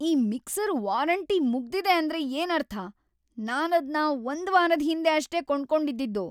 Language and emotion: Kannada, angry